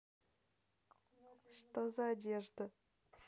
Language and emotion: Russian, neutral